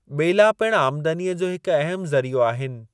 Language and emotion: Sindhi, neutral